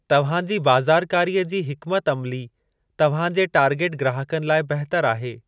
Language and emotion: Sindhi, neutral